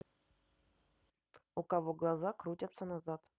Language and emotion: Russian, neutral